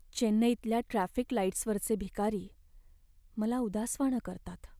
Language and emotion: Marathi, sad